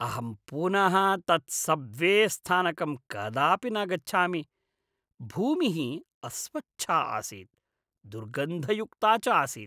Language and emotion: Sanskrit, disgusted